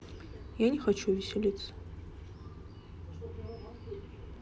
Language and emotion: Russian, sad